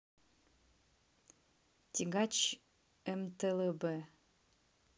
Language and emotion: Russian, neutral